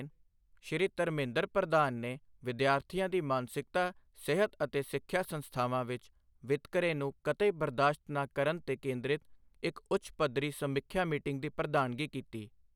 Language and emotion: Punjabi, neutral